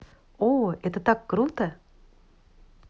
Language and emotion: Russian, positive